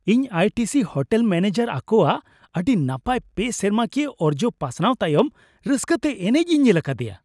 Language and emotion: Santali, happy